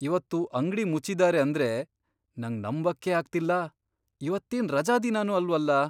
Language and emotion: Kannada, surprised